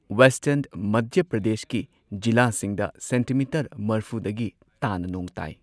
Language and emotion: Manipuri, neutral